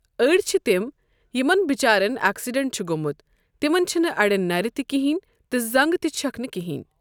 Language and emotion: Kashmiri, neutral